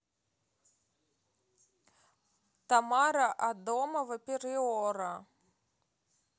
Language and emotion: Russian, neutral